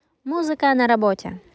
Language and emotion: Russian, positive